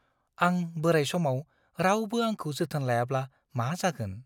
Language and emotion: Bodo, fearful